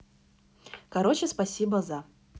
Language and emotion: Russian, neutral